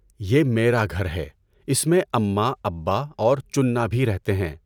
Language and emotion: Urdu, neutral